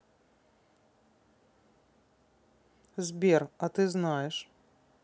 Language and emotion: Russian, neutral